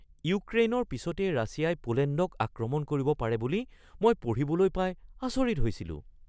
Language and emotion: Assamese, surprised